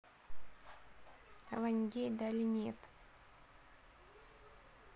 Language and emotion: Russian, neutral